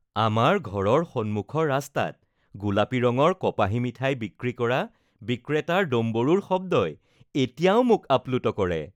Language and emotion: Assamese, happy